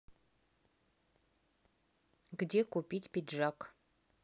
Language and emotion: Russian, neutral